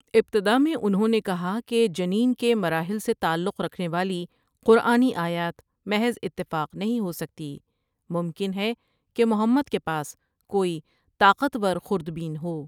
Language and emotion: Urdu, neutral